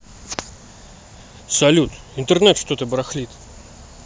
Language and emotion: Russian, neutral